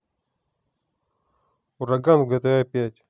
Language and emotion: Russian, neutral